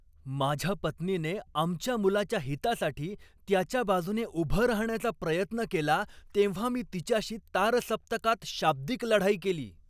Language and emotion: Marathi, angry